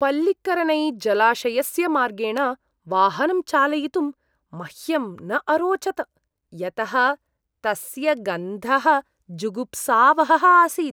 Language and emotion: Sanskrit, disgusted